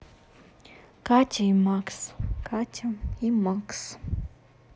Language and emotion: Russian, neutral